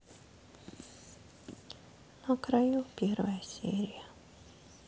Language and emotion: Russian, sad